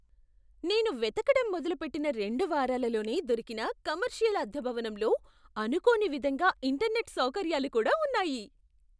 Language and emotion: Telugu, surprised